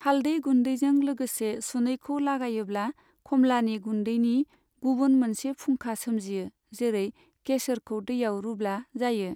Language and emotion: Bodo, neutral